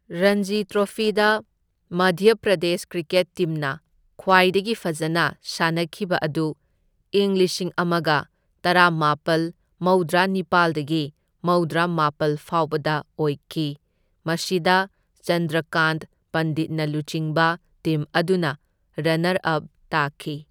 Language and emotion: Manipuri, neutral